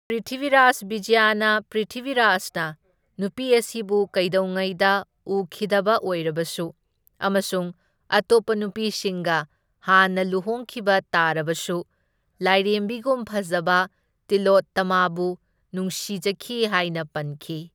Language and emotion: Manipuri, neutral